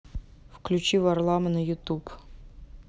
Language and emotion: Russian, neutral